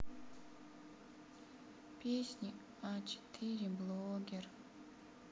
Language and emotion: Russian, sad